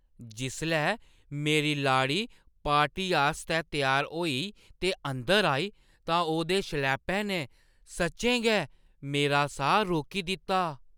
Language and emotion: Dogri, surprised